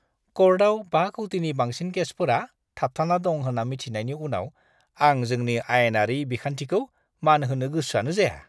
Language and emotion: Bodo, disgusted